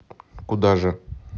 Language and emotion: Russian, neutral